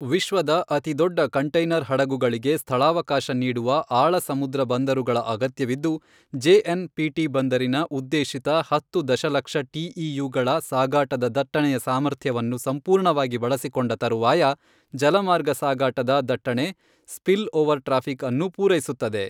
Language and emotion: Kannada, neutral